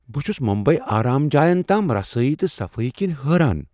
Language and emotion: Kashmiri, surprised